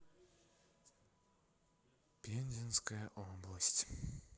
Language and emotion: Russian, sad